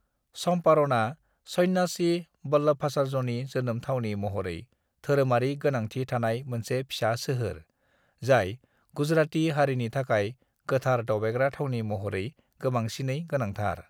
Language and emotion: Bodo, neutral